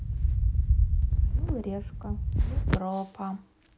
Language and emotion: Russian, neutral